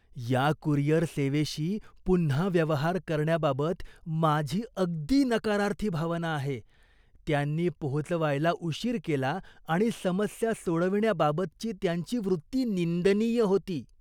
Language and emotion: Marathi, disgusted